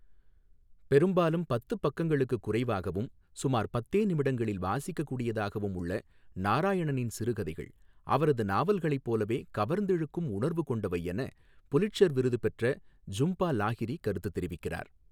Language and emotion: Tamil, neutral